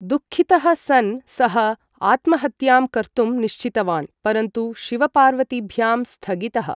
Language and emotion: Sanskrit, neutral